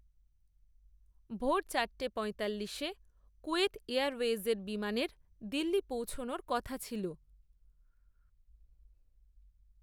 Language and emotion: Bengali, neutral